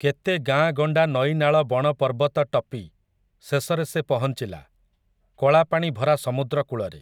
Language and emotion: Odia, neutral